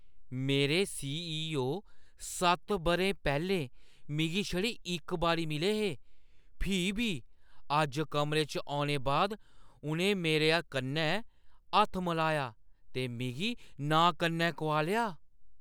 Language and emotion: Dogri, surprised